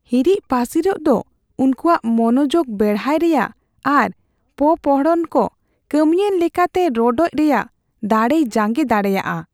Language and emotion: Santali, fearful